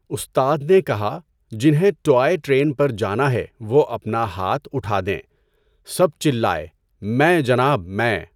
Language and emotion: Urdu, neutral